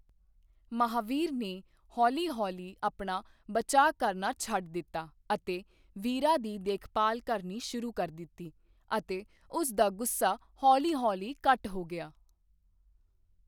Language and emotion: Punjabi, neutral